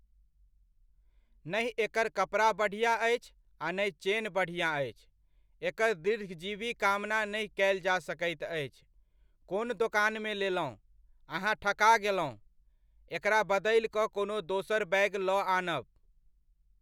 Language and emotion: Maithili, neutral